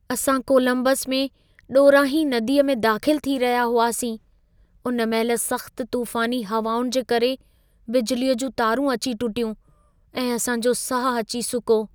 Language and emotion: Sindhi, fearful